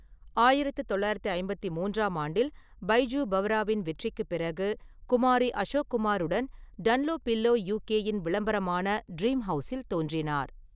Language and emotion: Tamil, neutral